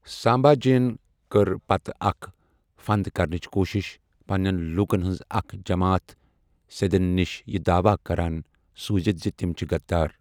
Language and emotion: Kashmiri, neutral